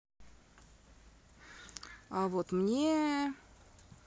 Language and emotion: Russian, neutral